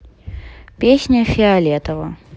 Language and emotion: Russian, neutral